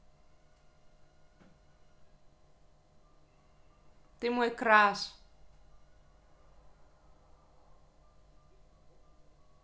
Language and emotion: Russian, positive